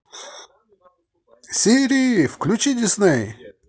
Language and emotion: Russian, positive